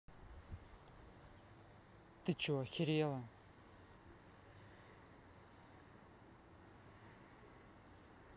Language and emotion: Russian, angry